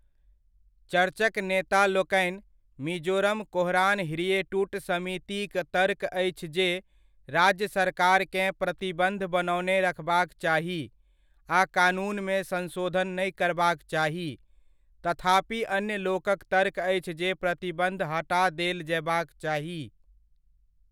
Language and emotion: Maithili, neutral